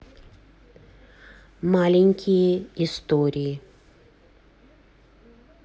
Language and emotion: Russian, neutral